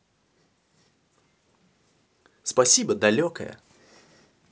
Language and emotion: Russian, positive